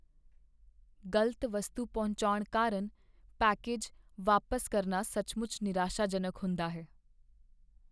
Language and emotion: Punjabi, sad